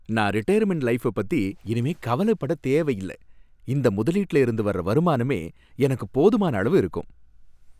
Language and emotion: Tamil, happy